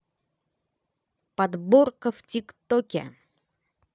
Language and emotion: Russian, positive